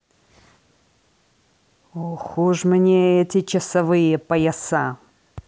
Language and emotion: Russian, angry